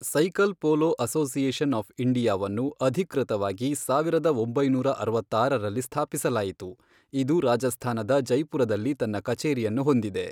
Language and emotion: Kannada, neutral